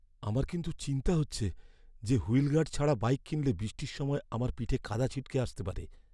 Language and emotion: Bengali, fearful